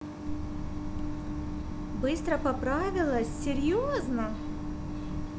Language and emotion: Russian, positive